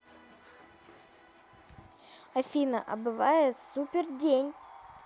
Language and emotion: Russian, neutral